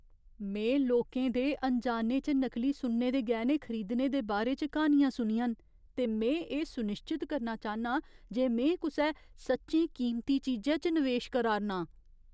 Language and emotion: Dogri, fearful